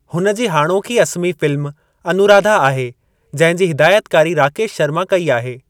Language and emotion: Sindhi, neutral